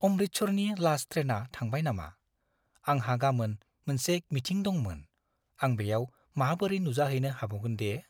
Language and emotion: Bodo, fearful